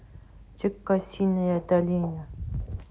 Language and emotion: Russian, neutral